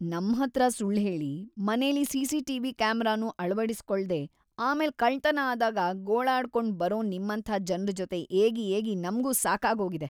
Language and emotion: Kannada, disgusted